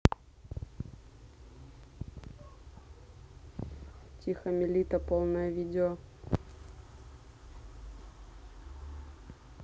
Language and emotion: Russian, neutral